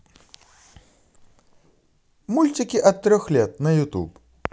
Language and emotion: Russian, positive